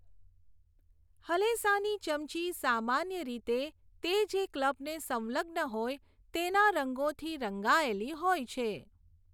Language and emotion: Gujarati, neutral